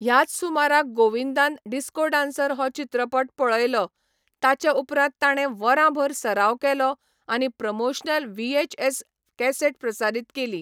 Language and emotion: Goan Konkani, neutral